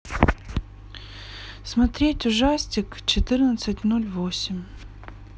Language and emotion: Russian, sad